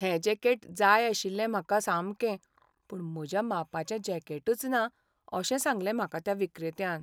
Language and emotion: Goan Konkani, sad